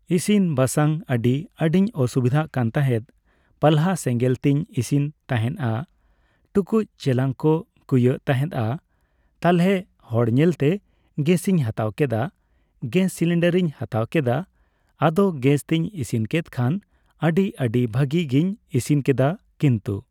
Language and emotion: Santali, neutral